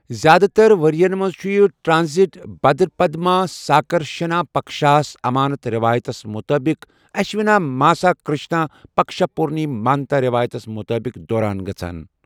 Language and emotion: Kashmiri, neutral